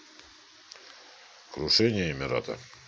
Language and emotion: Russian, neutral